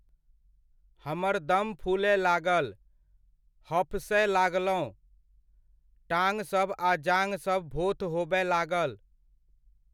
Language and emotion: Maithili, neutral